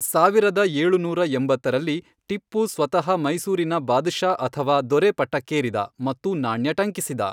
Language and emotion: Kannada, neutral